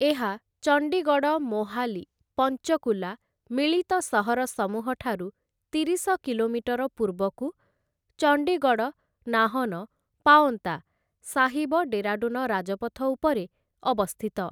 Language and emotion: Odia, neutral